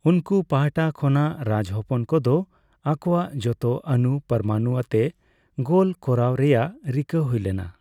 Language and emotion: Santali, neutral